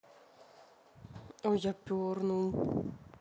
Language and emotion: Russian, neutral